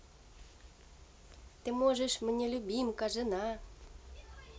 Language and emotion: Russian, positive